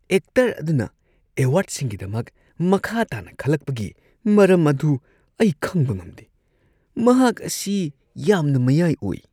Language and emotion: Manipuri, disgusted